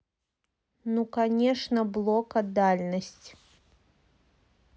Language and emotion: Russian, neutral